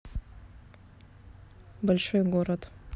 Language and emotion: Russian, neutral